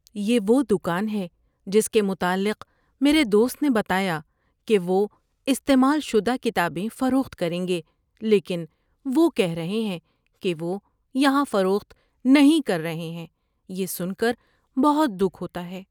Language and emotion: Urdu, sad